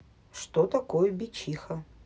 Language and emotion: Russian, neutral